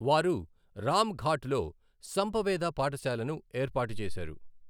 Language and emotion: Telugu, neutral